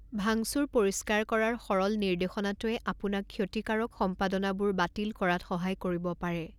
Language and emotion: Assamese, neutral